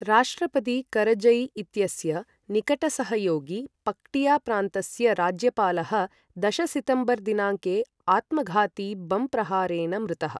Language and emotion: Sanskrit, neutral